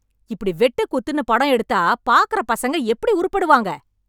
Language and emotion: Tamil, angry